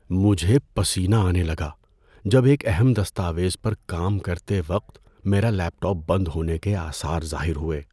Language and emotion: Urdu, fearful